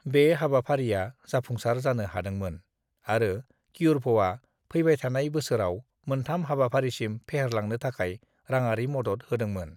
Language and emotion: Bodo, neutral